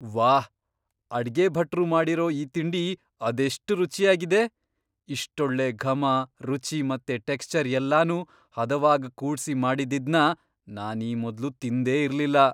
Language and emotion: Kannada, surprised